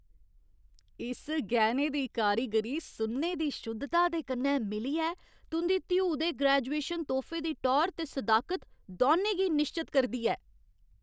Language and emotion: Dogri, happy